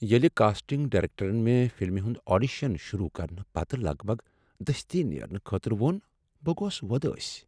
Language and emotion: Kashmiri, sad